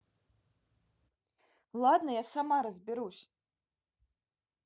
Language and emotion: Russian, neutral